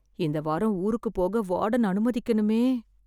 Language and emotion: Tamil, fearful